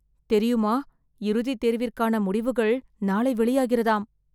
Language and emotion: Tamil, fearful